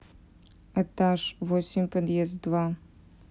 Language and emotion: Russian, neutral